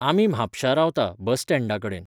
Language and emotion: Goan Konkani, neutral